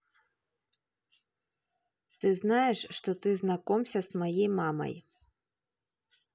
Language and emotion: Russian, neutral